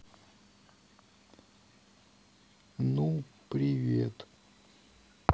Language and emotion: Russian, neutral